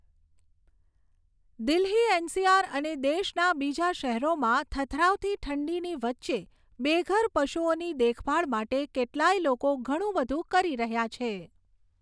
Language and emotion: Gujarati, neutral